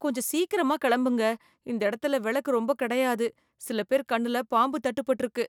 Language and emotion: Tamil, fearful